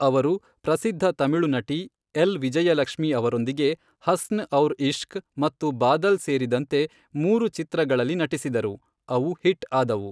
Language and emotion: Kannada, neutral